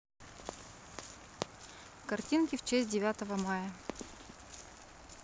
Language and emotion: Russian, neutral